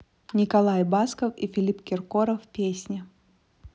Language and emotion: Russian, neutral